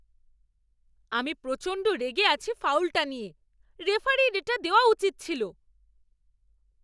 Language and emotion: Bengali, angry